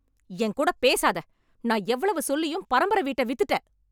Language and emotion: Tamil, angry